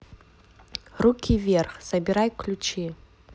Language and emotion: Russian, neutral